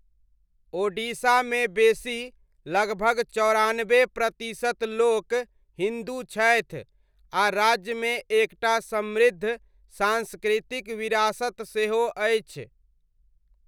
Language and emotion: Maithili, neutral